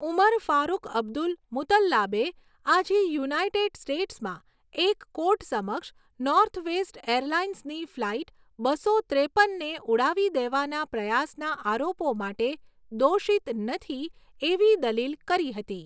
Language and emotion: Gujarati, neutral